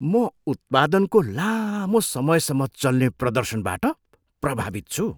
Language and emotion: Nepali, surprised